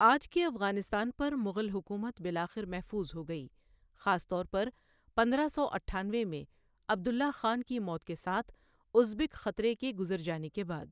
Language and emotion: Urdu, neutral